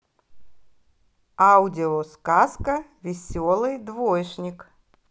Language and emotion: Russian, positive